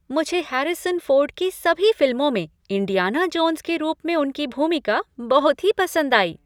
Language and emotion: Hindi, happy